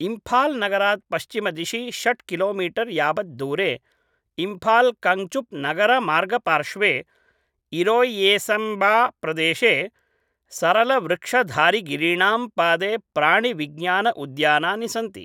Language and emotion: Sanskrit, neutral